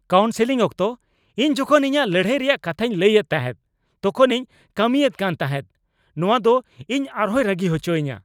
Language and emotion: Santali, angry